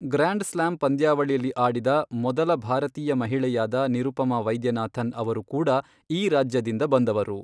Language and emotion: Kannada, neutral